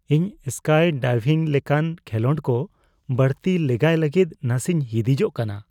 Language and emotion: Santali, fearful